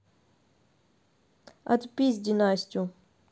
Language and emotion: Russian, neutral